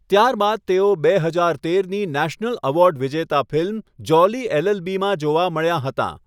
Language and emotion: Gujarati, neutral